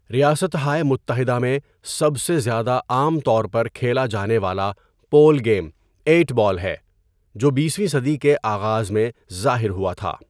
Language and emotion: Urdu, neutral